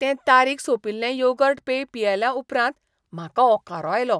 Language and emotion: Goan Konkani, disgusted